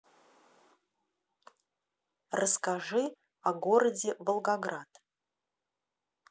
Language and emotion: Russian, neutral